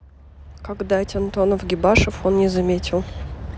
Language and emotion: Russian, neutral